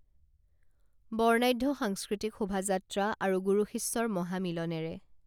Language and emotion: Assamese, neutral